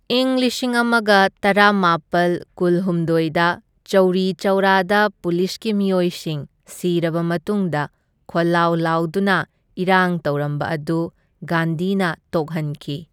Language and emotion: Manipuri, neutral